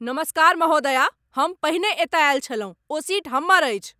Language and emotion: Maithili, angry